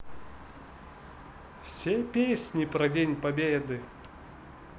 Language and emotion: Russian, positive